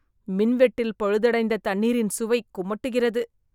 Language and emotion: Tamil, disgusted